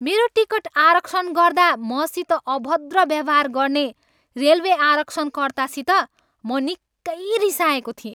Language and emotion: Nepali, angry